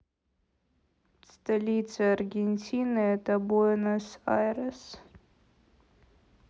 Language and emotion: Russian, sad